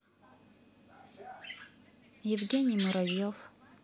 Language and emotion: Russian, neutral